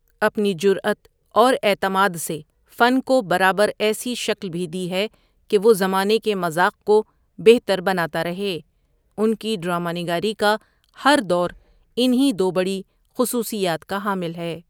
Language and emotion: Urdu, neutral